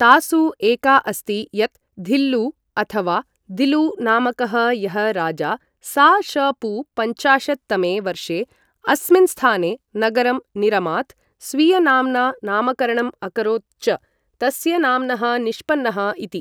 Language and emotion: Sanskrit, neutral